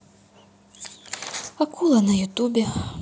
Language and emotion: Russian, sad